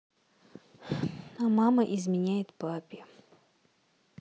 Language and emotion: Russian, sad